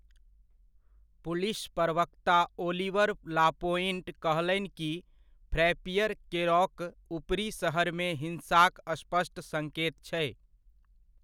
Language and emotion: Maithili, neutral